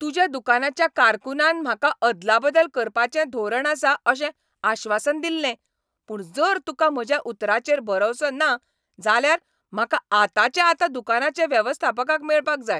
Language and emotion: Goan Konkani, angry